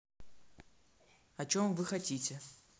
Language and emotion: Russian, neutral